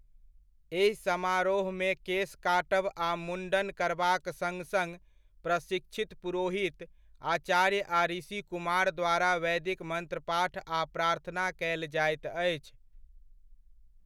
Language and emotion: Maithili, neutral